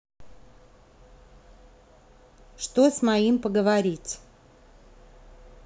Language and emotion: Russian, neutral